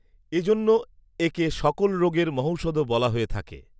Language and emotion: Bengali, neutral